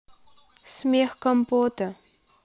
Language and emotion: Russian, neutral